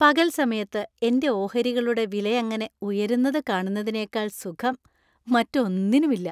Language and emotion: Malayalam, happy